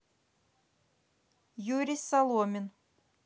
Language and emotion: Russian, neutral